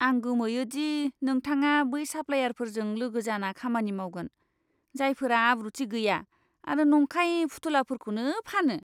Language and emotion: Bodo, disgusted